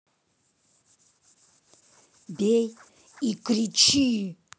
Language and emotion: Russian, angry